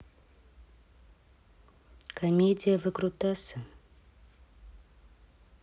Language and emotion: Russian, neutral